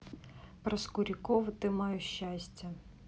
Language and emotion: Russian, neutral